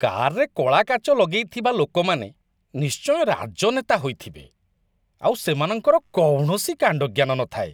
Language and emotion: Odia, disgusted